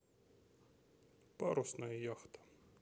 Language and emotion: Russian, neutral